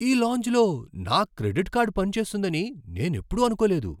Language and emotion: Telugu, surprised